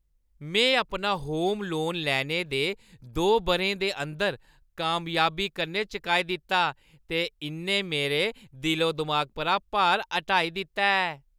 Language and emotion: Dogri, happy